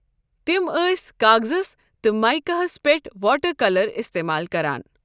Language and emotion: Kashmiri, neutral